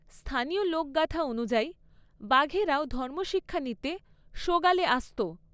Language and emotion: Bengali, neutral